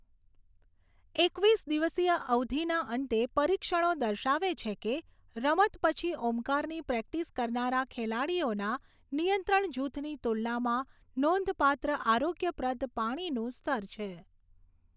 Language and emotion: Gujarati, neutral